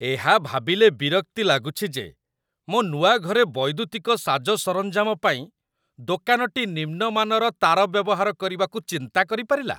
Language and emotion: Odia, disgusted